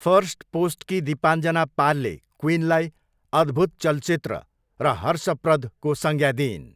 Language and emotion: Nepali, neutral